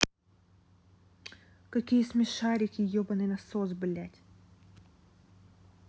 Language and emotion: Russian, angry